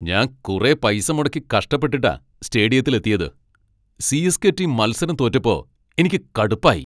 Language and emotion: Malayalam, angry